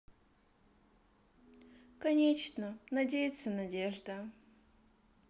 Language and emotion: Russian, sad